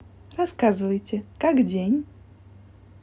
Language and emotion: Russian, positive